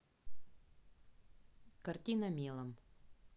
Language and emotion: Russian, neutral